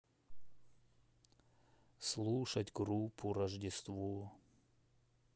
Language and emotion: Russian, sad